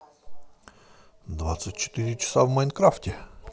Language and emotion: Russian, positive